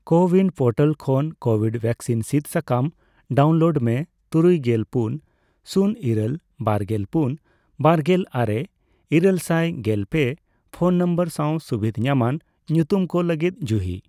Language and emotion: Santali, neutral